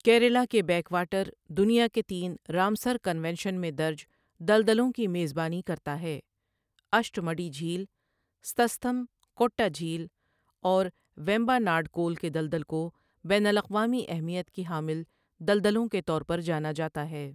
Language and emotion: Urdu, neutral